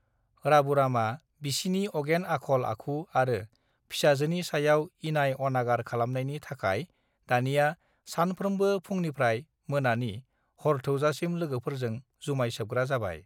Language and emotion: Bodo, neutral